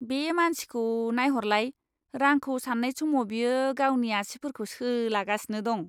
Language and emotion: Bodo, disgusted